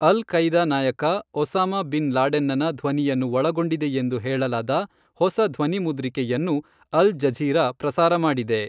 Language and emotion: Kannada, neutral